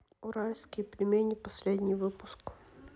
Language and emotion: Russian, neutral